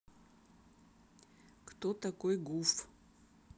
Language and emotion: Russian, neutral